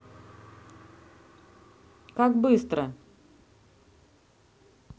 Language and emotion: Russian, neutral